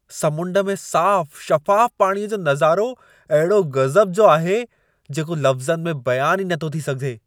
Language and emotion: Sindhi, surprised